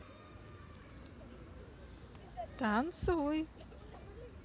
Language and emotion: Russian, positive